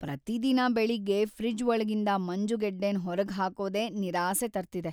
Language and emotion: Kannada, sad